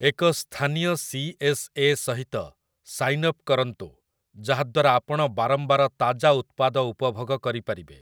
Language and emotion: Odia, neutral